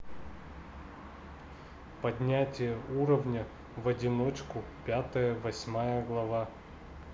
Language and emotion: Russian, neutral